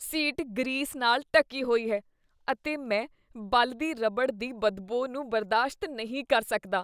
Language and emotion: Punjabi, disgusted